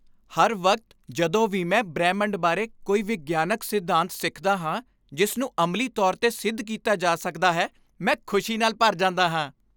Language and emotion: Punjabi, happy